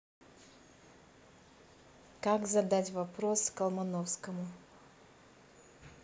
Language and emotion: Russian, neutral